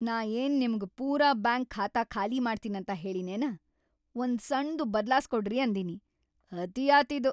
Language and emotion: Kannada, angry